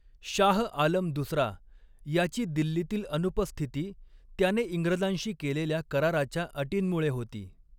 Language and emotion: Marathi, neutral